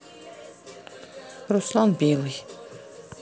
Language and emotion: Russian, neutral